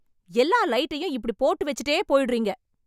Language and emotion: Tamil, angry